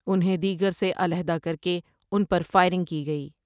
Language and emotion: Urdu, neutral